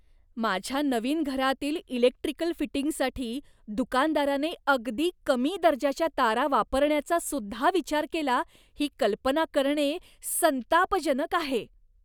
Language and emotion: Marathi, disgusted